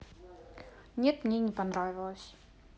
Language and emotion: Russian, sad